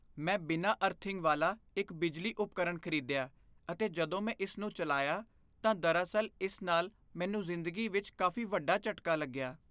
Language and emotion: Punjabi, fearful